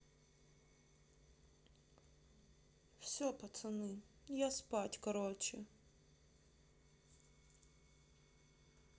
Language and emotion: Russian, sad